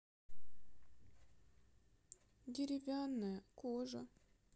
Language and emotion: Russian, sad